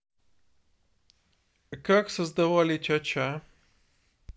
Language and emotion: Russian, neutral